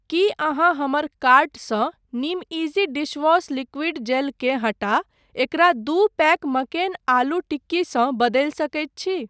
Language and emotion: Maithili, neutral